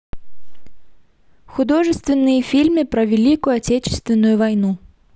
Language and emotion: Russian, neutral